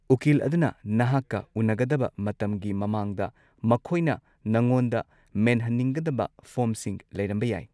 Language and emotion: Manipuri, neutral